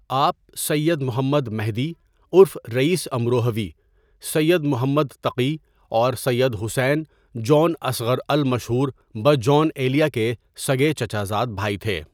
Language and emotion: Urdu, neutral